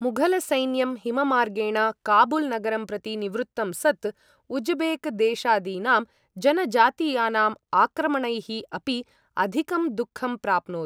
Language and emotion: Sanskrit, neutral